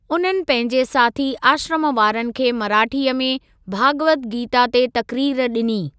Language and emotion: Sindhi, neutral